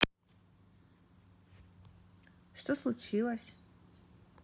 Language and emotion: Russian, neutral